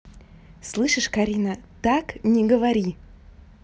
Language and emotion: Russian, neutral